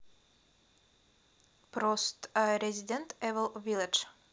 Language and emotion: Russian, neutral